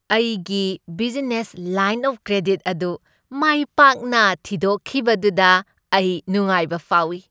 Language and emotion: Manipuri, happy